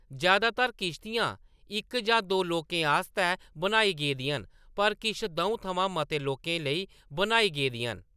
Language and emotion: Dogri, neutral